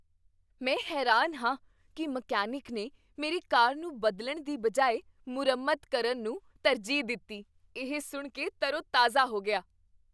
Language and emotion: Punjabi, surprised